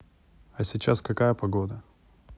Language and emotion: Russian, neutral